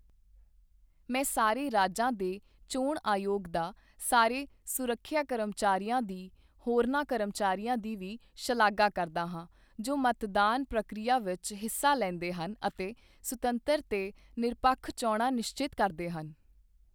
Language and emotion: Punjabi, neutral